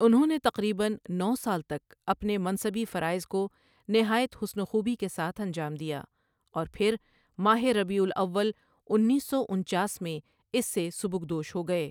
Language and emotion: Urdu, neutral